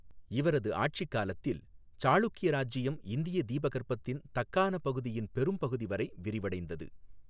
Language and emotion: Tamil, neutral